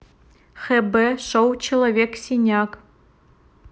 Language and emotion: Russian, neutral